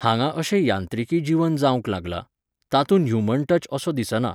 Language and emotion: Goan Konkani, neutral